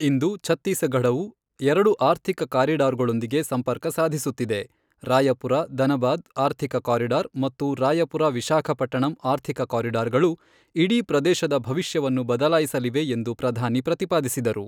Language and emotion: Kannada, neutral